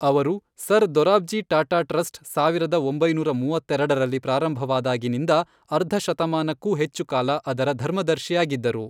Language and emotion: Kannada, neutral